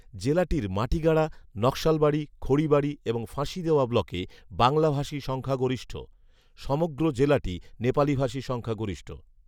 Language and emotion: Bengali, neutral